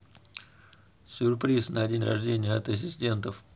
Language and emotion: Russian, neutral